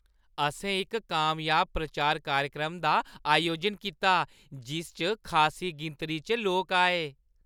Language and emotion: Dogri, happy